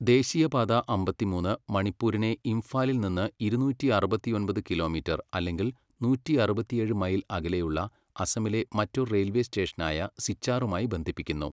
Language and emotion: Malayalam, neutral